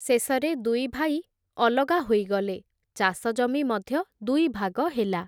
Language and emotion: Odia, neutral